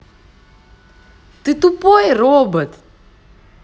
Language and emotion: Russian, positive